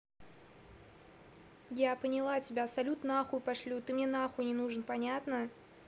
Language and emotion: Russian, angry